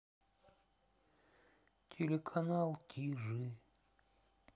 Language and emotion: Russian, sad